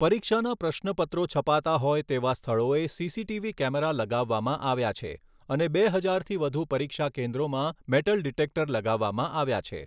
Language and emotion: Gujarati, neutral